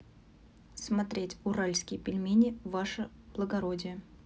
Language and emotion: Russian, neutral